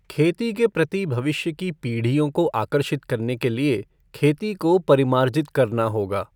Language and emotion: Hindi, neutral